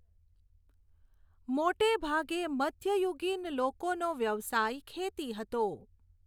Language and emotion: Gujarati, neutral